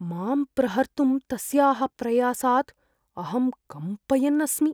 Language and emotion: Sanskrit, fearful